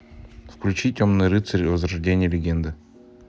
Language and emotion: Russian, neutral